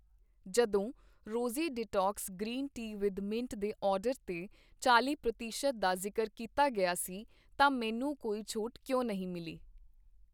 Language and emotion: Punjabi, neutral